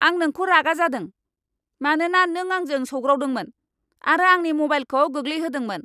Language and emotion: Bodo, angry